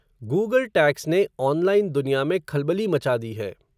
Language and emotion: Hindi, neutral